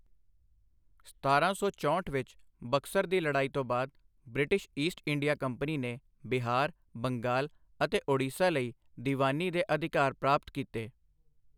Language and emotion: Punjabi, neutral